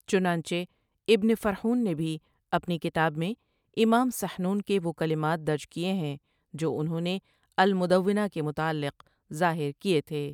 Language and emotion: Urdu, neutral